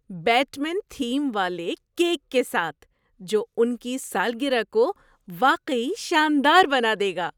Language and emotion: Urdu, surprised